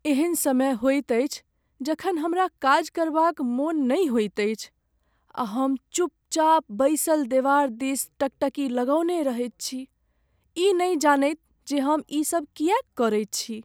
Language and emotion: Maithili, sad